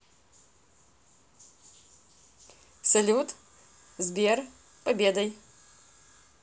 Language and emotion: Russian, positive